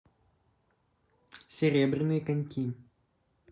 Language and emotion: Russian, neutral